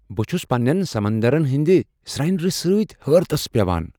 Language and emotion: Kashmiri, surprised